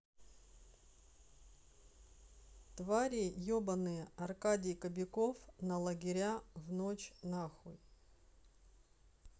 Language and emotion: Russian, neutral